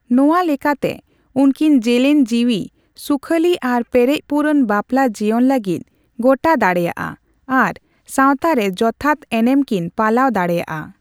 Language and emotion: Santali, neutral